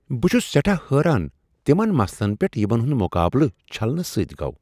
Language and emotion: Kashmiri, surprised